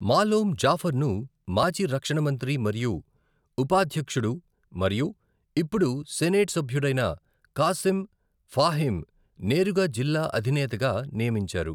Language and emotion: Telugu, neutral